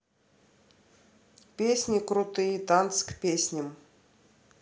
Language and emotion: Russian, neutral